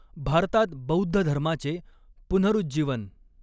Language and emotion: Marathi, neutral